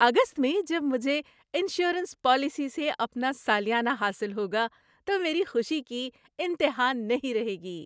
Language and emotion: Urdu, happy